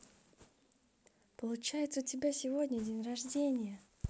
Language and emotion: Russian, positive